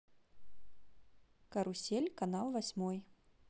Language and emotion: Russian, neutral